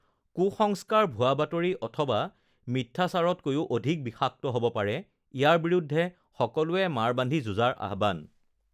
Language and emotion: Assamese, neutral